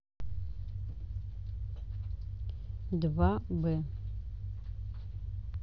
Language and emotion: Russian, neutral